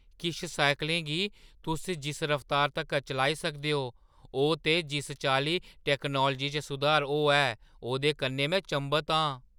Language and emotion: Dogri, surprised